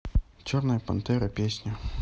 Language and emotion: Russian, neutral